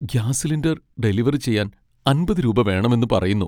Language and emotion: Malayalam, sad